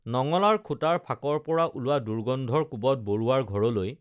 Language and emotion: Assamese, neutral